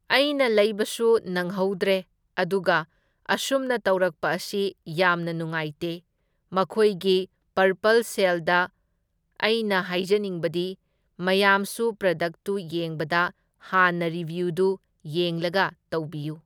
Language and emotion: Manipuri, neutral